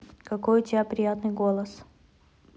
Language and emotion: Russian, neutral